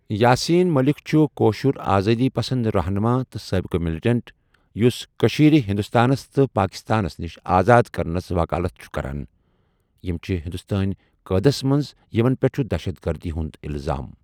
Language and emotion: Kashmiri, neutral